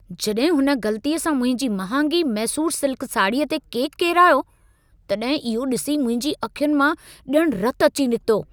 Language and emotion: Sindhi, angry